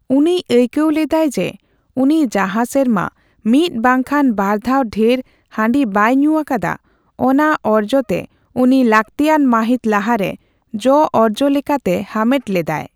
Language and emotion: Santali, neutral